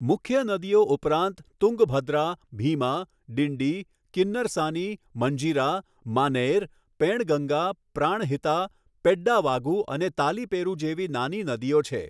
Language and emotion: Gujarati, neutral